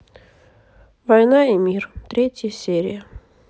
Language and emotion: Russian, sad